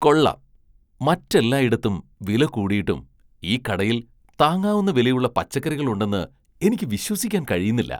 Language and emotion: Malayalam, surprised